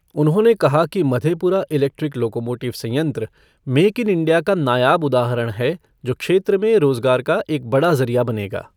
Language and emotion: Hindi, neutral